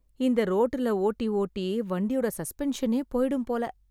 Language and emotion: Tamil, sad